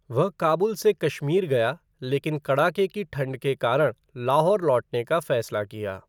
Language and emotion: Hindi, neutral